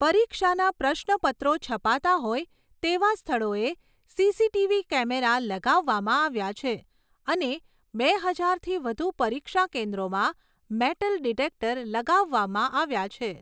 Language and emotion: Gujarati, neutral